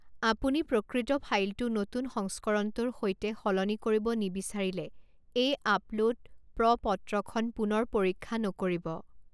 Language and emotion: Assamese, neutral